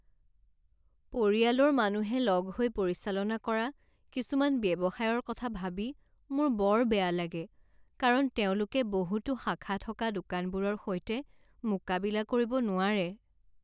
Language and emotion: Assamese, sad